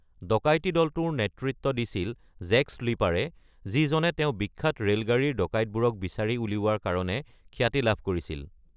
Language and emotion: Assamese, neutral